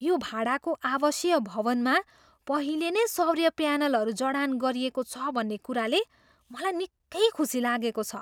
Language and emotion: Nepali, surprised